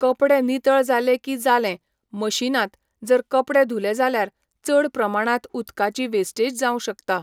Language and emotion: Goan Konkani, neutral